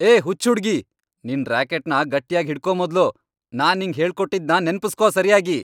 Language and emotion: Kannada, angry